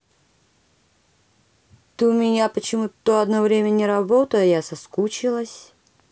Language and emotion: Russian, neutral